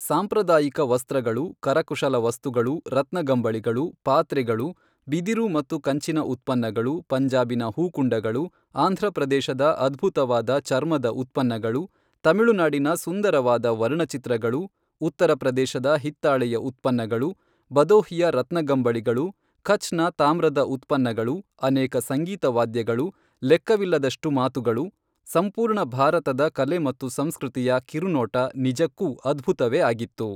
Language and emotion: Kannada, neutral